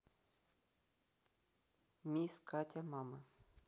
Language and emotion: Russian, neutral